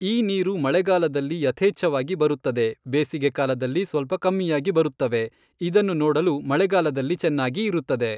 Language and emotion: Kannada, neutral